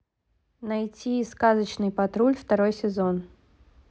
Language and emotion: Russian, neutral